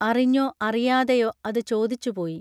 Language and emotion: Malayalam, neutral